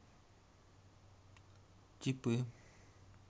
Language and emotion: Russian, neutral